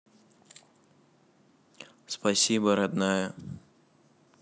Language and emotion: Russian, neutral